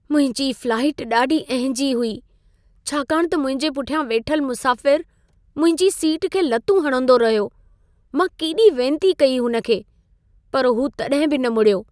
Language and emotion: Sindhi, sad